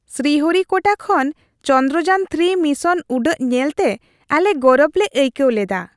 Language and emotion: Santali, happy